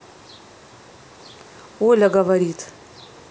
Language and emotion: Russian, neutral